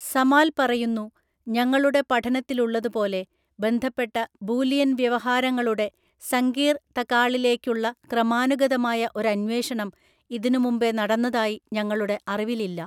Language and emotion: Malayalam, neutral